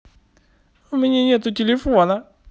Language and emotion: Russian, sad